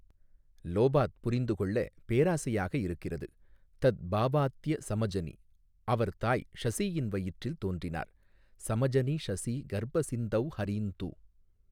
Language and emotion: Tamil, neutral